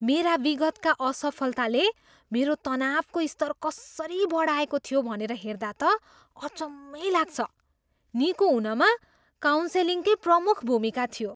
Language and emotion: Nepali, surprised